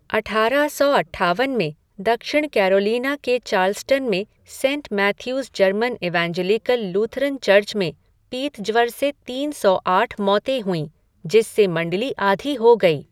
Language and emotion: Hindi, neutral